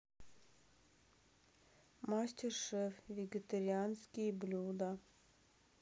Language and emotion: Russian, sad